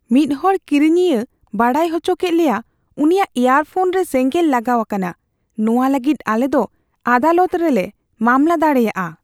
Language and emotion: Santali, fearful